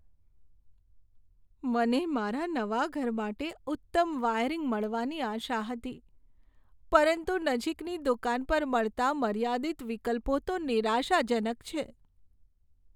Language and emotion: Gujarati, sad